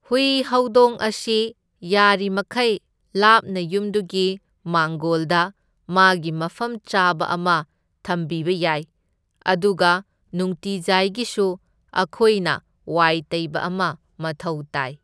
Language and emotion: Manipuri, neutral